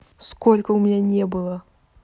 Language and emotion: Russian, neutral